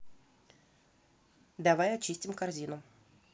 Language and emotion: Russian, neutral